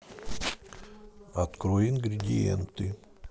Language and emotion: Russian, neutral